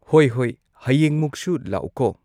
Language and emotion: Manipuri, neutral